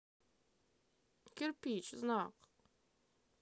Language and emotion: Russian, neutral